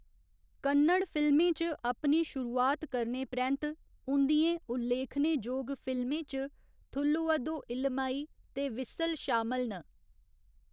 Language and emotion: Dogri, neutral